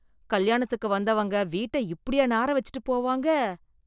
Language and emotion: Tamil, disgusted